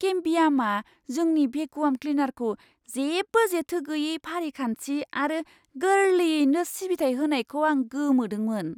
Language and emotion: Bodo, surprised